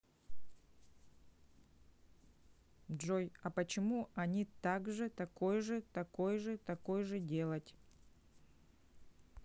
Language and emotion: Russian, neutral